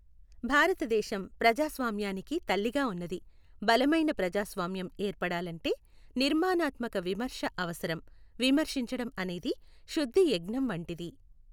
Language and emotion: Telugu, neutral